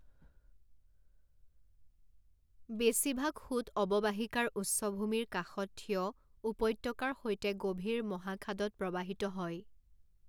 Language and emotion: Assamese, neutral